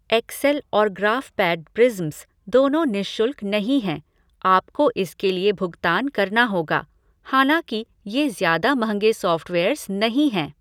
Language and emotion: Hindi, neutral